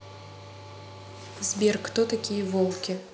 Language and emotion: Russian, neutral